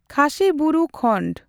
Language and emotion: Santali, neutral